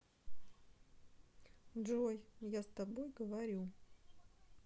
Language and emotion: Russian, neutral